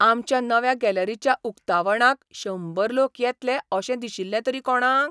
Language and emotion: Goan Konkani, surprised